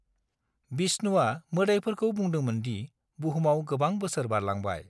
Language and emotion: Bodo, neutral